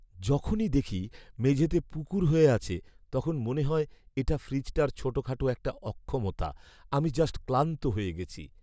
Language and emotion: Bengali, sad